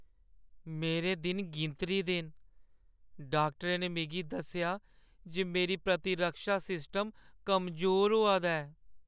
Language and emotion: Dogri, sad